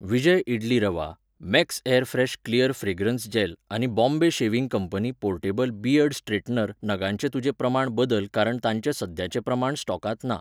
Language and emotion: Goan Konkani, neutral